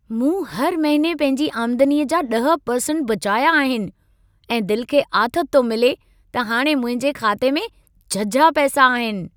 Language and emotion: Sindhi, happy